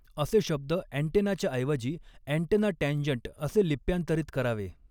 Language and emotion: Marathi, neutral